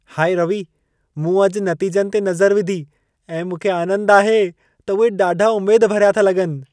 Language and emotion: Sindhi, happy